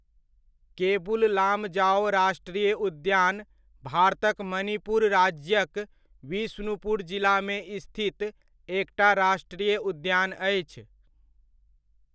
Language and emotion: Maithili, neutral